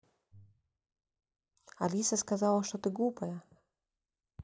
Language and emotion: Russian, neutral